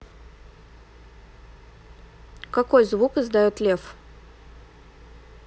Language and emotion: Russian, neutral